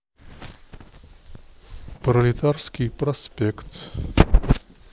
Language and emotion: Russian, neutral